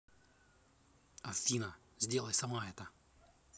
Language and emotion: Russian, angry